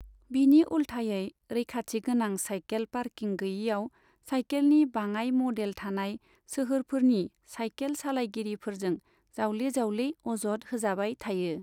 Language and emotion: Bodo, neutral